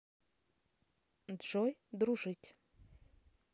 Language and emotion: Russian, neutral